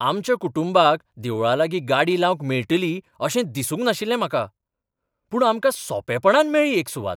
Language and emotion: Goan Konkani, surprised